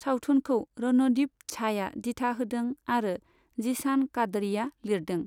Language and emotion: Bodo, neutral